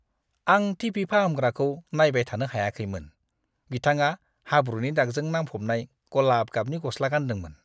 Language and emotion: Bodo, disgusted